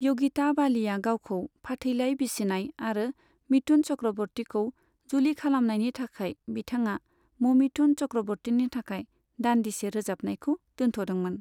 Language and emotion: Bodo, neutral